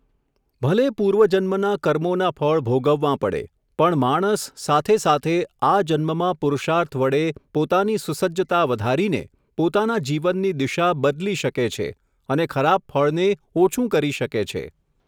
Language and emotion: Gujarati, neutral